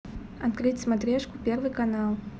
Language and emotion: Russian, neutral